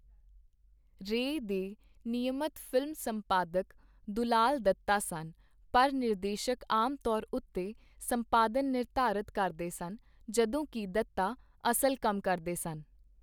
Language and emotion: Punjabi, neutral